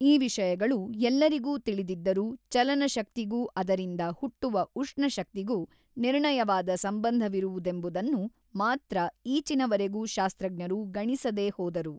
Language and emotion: Kannada, neutral